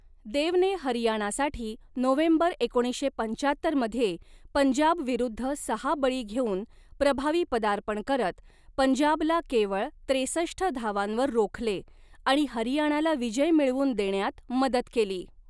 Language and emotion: Marathi, neutral